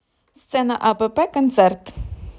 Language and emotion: Russian, positive